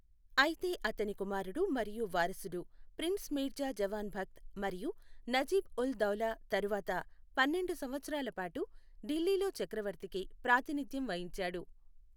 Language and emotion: Telugu, neutral